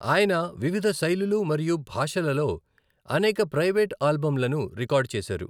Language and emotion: Telugu, neutral